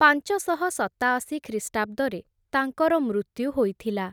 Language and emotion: Odia, neutral